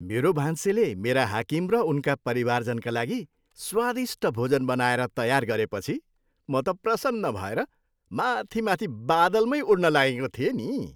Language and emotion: Nepali, happy